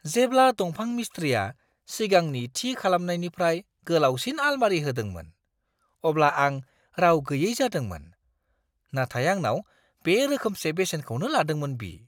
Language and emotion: Bodo, surprised